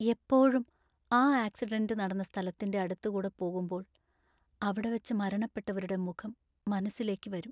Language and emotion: Malayalam, sad